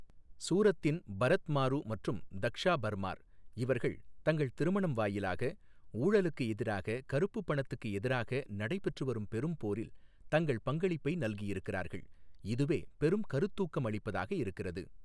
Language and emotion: Tamil, neutral